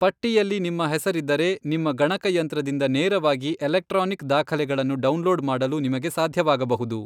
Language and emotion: Kannada, neutral